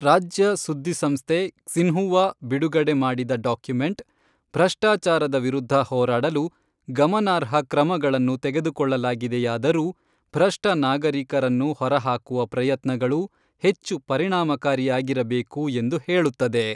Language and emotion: Kannada, neutral